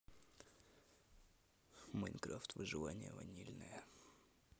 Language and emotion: Russian, neutral